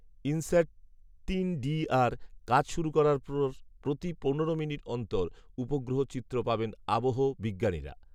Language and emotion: Bengali, neutral